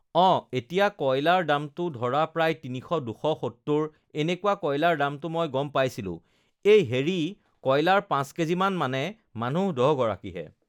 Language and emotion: Assamese, neutral